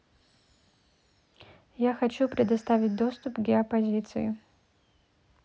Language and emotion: Russian, neutral